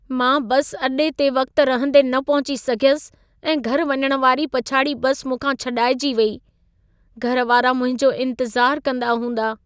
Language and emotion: Sindhi, sad